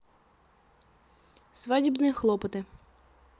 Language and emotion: Russian, neutral